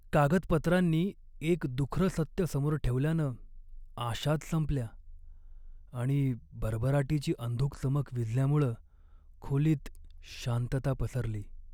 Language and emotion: Marathi, sad